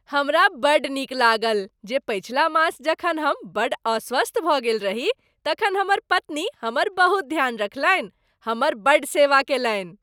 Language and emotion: Maithili, happy